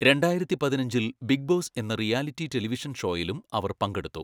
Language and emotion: Malayalam, neutral